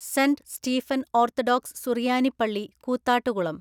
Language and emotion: Malayalam, neutral